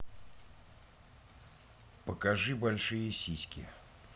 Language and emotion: Russian, neutral